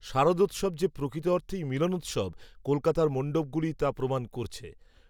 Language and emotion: Bengali, neutral